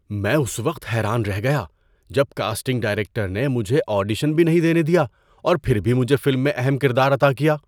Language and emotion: Urdu, surprised